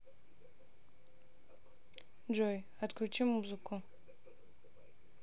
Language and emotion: Russian, neutral